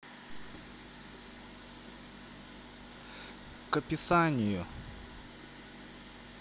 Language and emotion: Russian, neutral